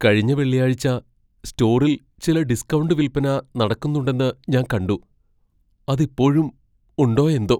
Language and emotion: Malayalam, fearful